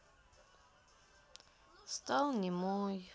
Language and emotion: Russian, sad